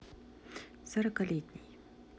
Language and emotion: Russian, neutral